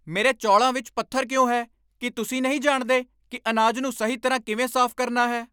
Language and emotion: Punjabi, angry